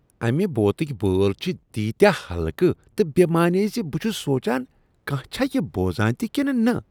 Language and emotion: Kashmiri, disgusted